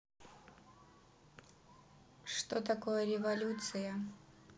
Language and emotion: Russian, neutral